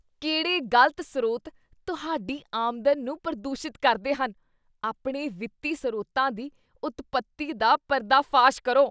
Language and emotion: Punjabi, disgusted